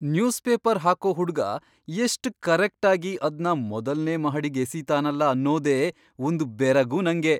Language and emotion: Kannada, surprised